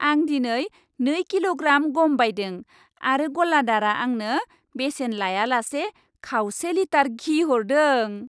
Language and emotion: Bodo, happy